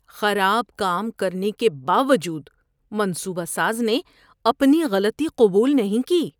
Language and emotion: Urdu, disgusted